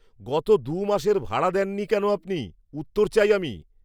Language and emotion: Bengali, angry